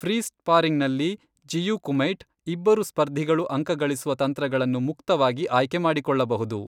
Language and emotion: Kannada, neutral